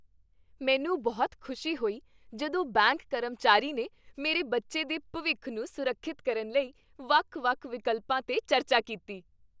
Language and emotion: Punjabi, happy